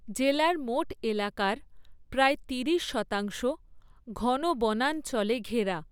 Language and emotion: Bengali, neutral